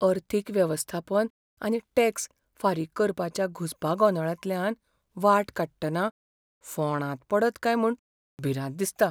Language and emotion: Goan Konkani, fearful